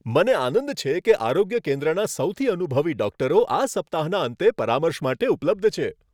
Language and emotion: Gujarati, happy